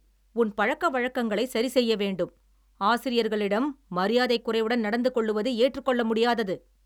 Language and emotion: Tamil, angry